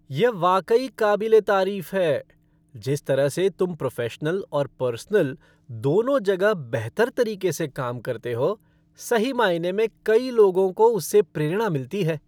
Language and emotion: Hindi, happy